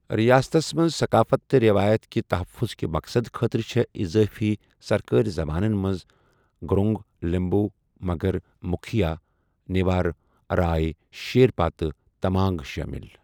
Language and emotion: Kashmiri, neutral